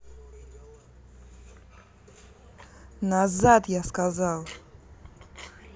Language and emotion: Russian, angry